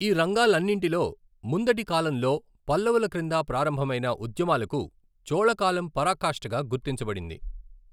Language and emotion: Telugu, neutral